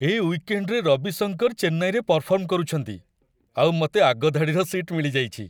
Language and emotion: Odia, happy